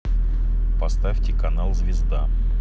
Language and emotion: Russian, neutral